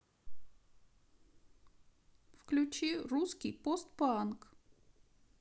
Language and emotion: Russian, sad